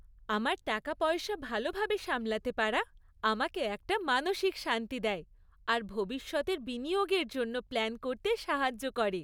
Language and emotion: Bengali, happy